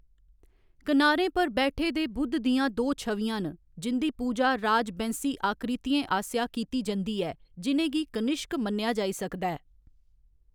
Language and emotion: Dogri, neutral